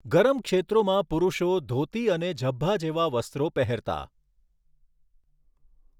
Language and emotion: Gujarati, neutral